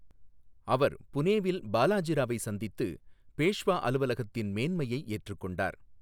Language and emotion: Tamil, neutral